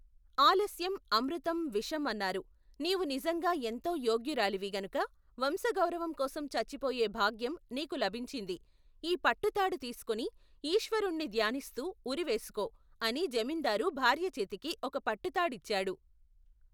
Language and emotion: Telugu, neutral